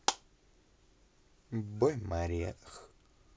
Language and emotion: Russian, positive